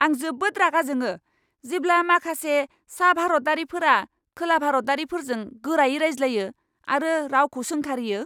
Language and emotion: Bodo, angry